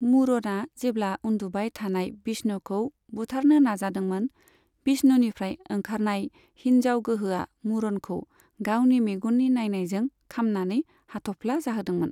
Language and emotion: Bodo, neutral